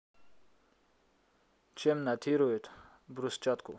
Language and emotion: Russian, neutral